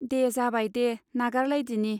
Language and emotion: Bodo, neutral